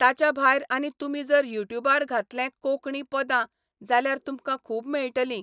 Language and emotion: Goan Konkani, neutral